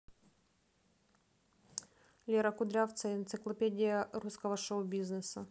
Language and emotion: Russian, neutral